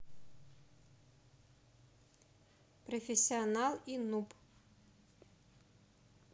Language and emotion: Russian, neutral